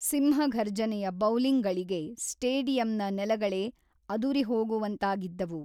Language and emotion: Kannada, neutral